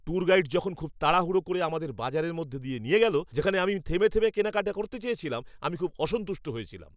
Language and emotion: Bengali, angry